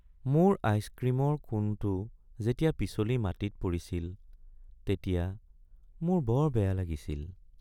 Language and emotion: Assamese, sad